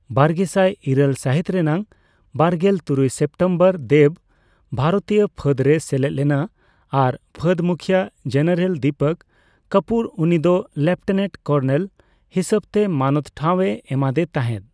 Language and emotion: Santali, neutral